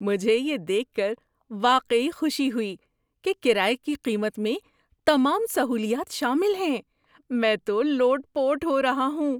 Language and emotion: Urdu, surprised